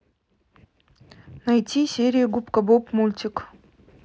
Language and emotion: Russian, neutral